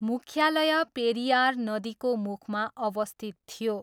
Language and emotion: Nepali, neutral